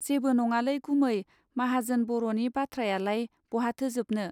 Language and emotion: Bodo, neutral